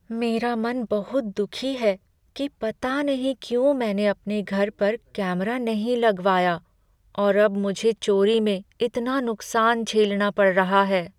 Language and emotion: Hindi, sad